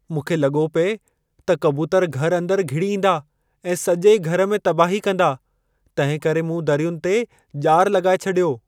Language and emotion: Sindhi, fearful